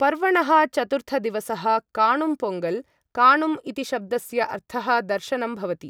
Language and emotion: Sanskrit, neutral